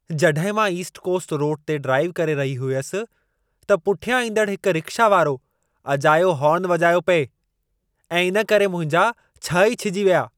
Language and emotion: Sindhi, angry